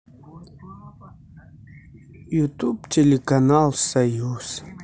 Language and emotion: Russian, sad